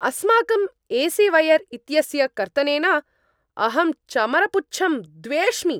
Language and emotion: Sanskrit, angry